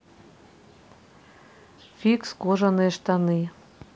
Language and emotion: Russian, neutral